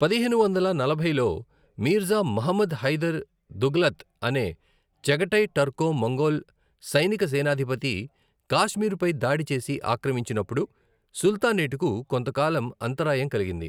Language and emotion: Telugu, neutral